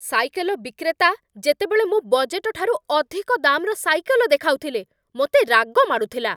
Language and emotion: Odia, angry